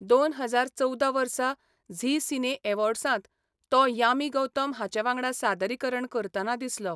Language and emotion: Goan Konkani, neutral